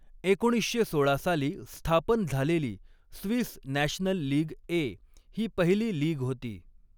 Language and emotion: Marathi, neutral